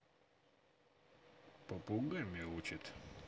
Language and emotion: Russian, neutral